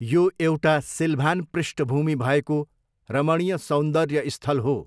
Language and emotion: Nepali, neutral